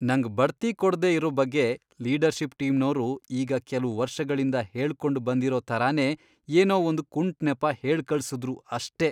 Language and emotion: Kannada, disgusted